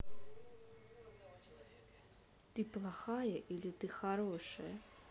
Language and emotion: Russian, neutral